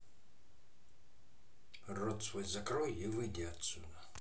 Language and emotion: Russian, angry